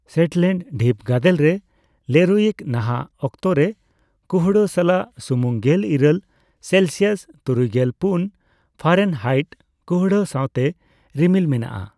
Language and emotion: Santali, neutral